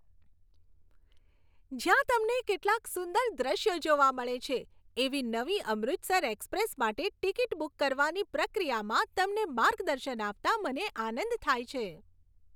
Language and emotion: Gujarati, happy